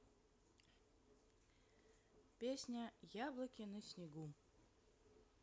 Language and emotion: Russian, neutral